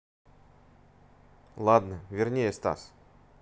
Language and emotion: Russian, neutral